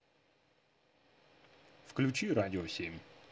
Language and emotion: Russian, neutral